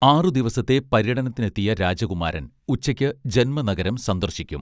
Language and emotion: Malayalam, neutral